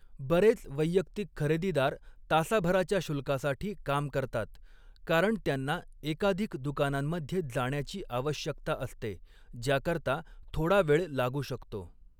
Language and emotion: Marathi, neutral